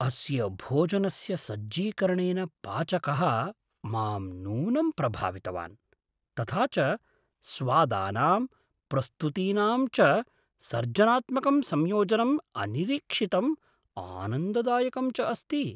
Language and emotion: Sanskrit, surprised